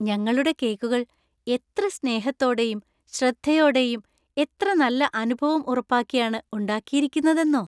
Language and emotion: Malayalam, happy